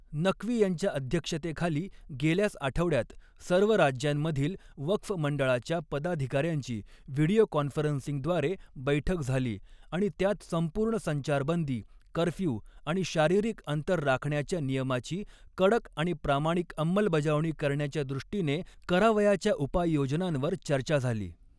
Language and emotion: Marathi, neutral